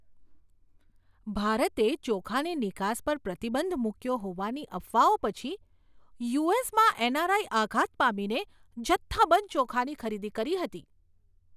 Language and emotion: Gujarati, surprised